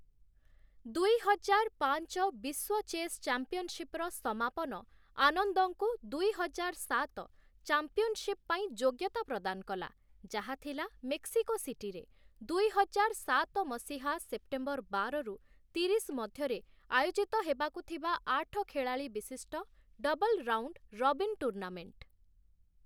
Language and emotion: Odia, neutral